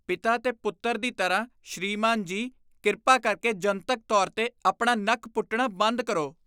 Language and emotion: Punjabi, disgusted